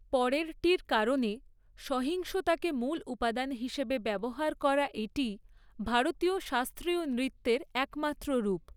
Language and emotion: Bengali, neutral